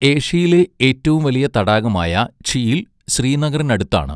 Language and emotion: Malayalam, neutral